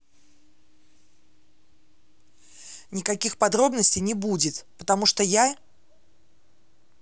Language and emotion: Russian, angry